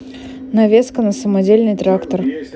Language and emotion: Russian, neutral